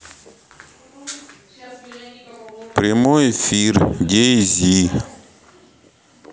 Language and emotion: Russian, neutral